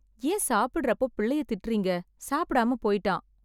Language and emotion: Tamil, sad